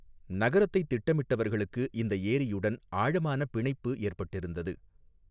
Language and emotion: Tamil, neutral